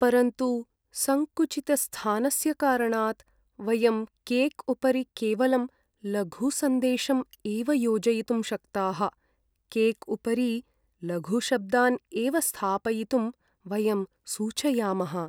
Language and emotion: Sanskrit, sad